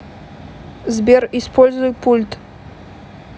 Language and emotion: Russian, neutral